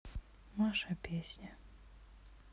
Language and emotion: Russian, sad